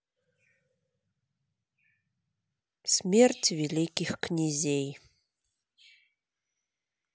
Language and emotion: Russian, neutral